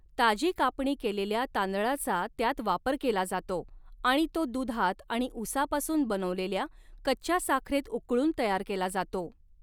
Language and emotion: Marathi, neutral